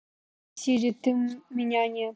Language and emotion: Russian, angry